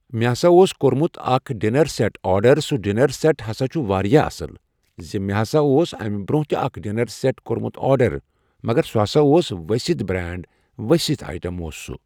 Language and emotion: Kashmiri, neutral